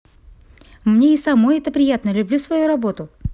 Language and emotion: Russian, positive